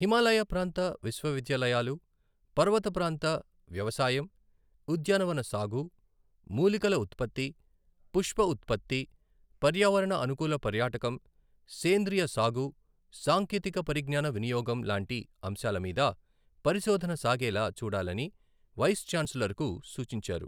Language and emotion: Telugu, neutral